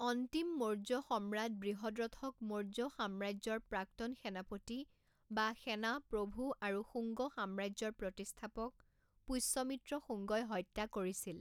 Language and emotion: Assamese, neutral